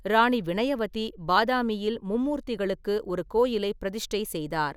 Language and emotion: Tamil, neutral